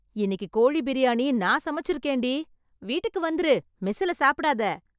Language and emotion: Tamil, happy